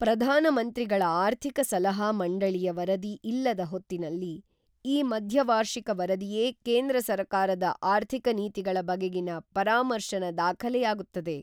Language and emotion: Kannada, neutral